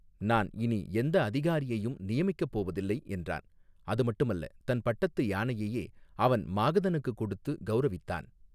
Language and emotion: Tamil, neutral